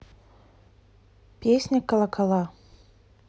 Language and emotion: Russian, neutral